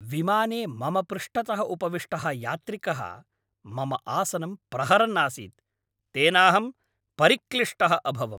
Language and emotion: Sanskrit, angry